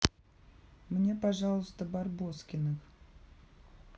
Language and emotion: Russian, neutral